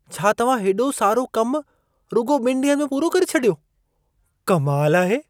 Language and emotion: Sindhi, surprised